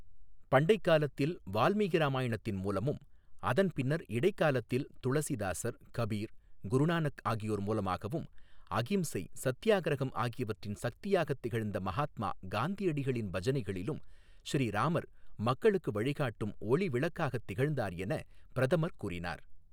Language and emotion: Tamil, neutral